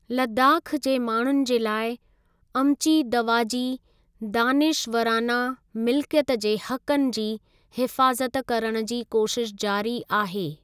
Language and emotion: Sindhi, neutral